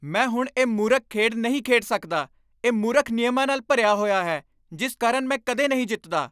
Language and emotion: Punjabi, angry